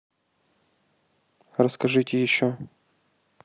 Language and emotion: Russian, neutral